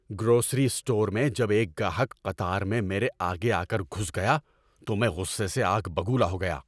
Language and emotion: Urdu, angry